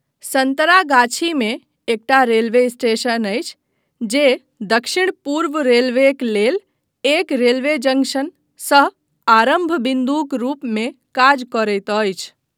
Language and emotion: Maithili, neutral